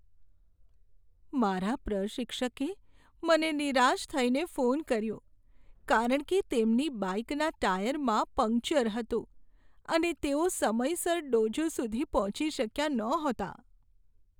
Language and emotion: Gujarati, sad